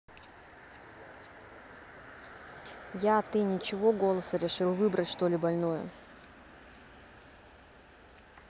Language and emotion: Russian, neutral